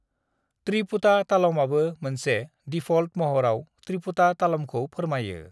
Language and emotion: Bodo, neutral